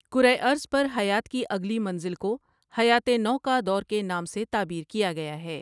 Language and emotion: Urdu, neutral